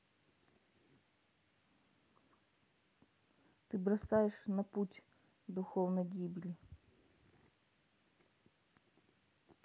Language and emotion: Russian, neutral